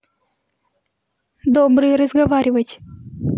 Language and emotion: Russian, neutral